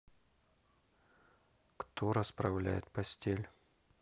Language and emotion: Russian, neutral